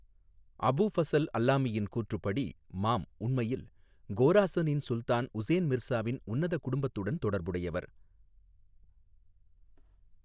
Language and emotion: Tamil, neutral